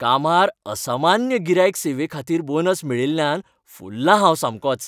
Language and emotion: Goan Konkani, happy